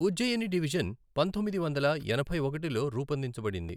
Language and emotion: Telugu, neutral